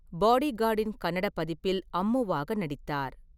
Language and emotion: Tamil, neutral